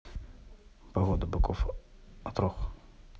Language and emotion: Russian, neutral